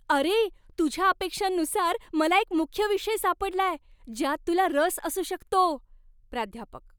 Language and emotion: Marathi, happy